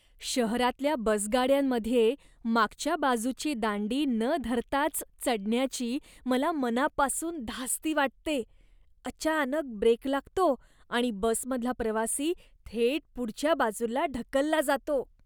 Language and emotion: Marathi, disgusted